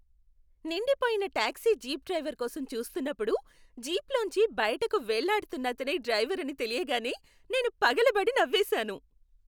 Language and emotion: Telugu, happy